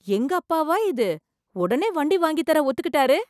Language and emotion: Tamil, surprised